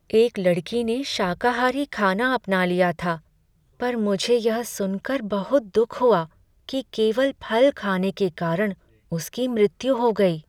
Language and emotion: Hindi, sad